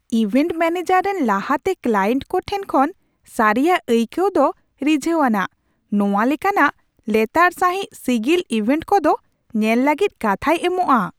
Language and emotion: Santali, surprised